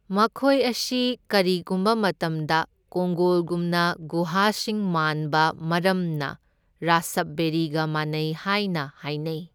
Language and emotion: Manipuri, neutral